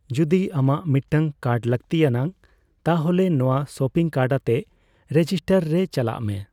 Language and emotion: Santali, neutral